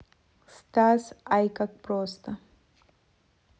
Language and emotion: Russian, neutral